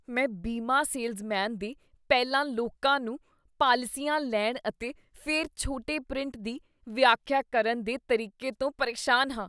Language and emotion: Punjabi, disgusted